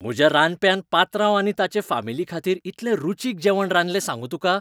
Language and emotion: Goan Konkani, happy